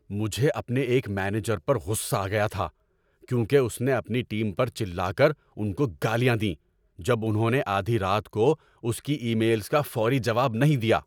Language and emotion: Urdu, angry